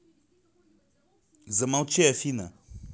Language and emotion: Russian, angry